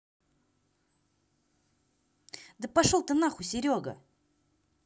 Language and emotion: Russian, angry